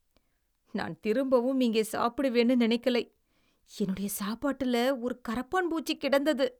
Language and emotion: Tamil, disgusted